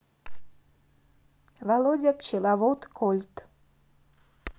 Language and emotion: Russian, neutral